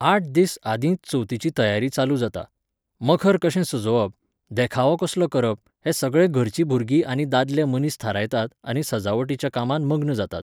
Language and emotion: Goan Konkani, neutral